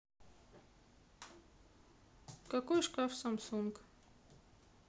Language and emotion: Russian, neutral